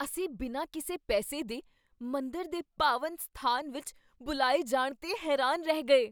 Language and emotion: Punjabi, surprised